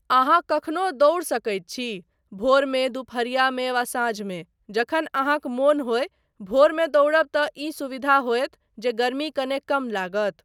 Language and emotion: Maithili, neutral